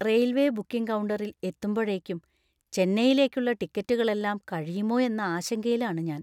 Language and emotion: Malayalam, fearful